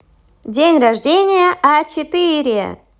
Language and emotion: Russian, positive